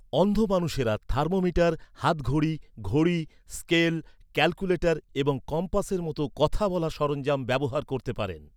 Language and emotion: Bengali, neutral